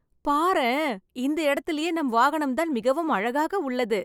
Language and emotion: Tamil, happy